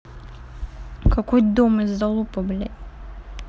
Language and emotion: Russian, angry